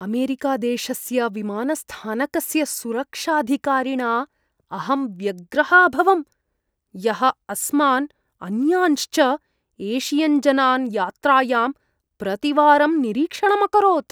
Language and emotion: Sanskrit, disgusted